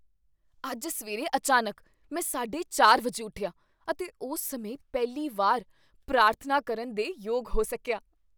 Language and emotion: Punjabi, surprised